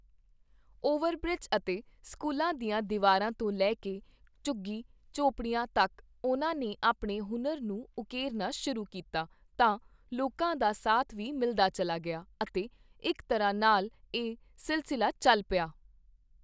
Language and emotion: Punjabi, neutral